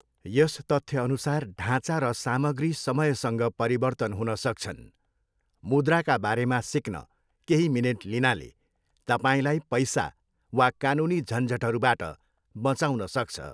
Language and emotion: Nepali, neutral